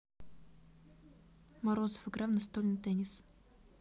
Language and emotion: Russian, neutral